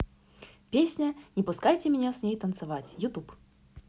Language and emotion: Russian, positive